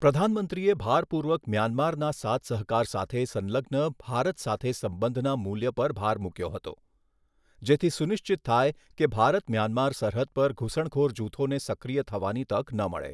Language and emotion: Gujarati, neutral